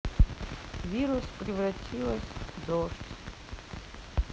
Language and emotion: Russian, sad